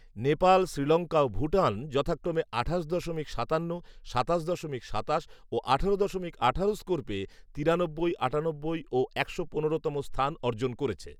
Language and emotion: Bengali, neutral